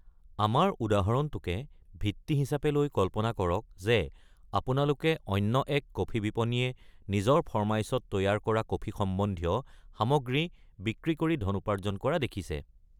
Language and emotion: Assamese, neutral